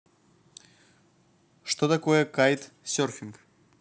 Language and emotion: Russian, neutral